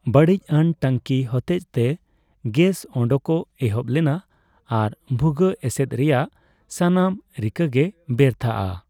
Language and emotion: Santali, neutral